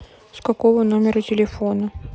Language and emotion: Russian, sad